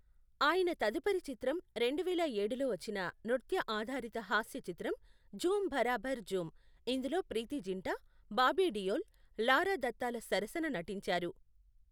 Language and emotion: Telugu, neutral